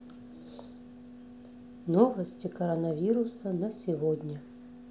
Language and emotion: Russian, neutral